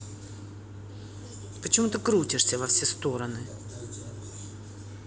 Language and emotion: Russian, angry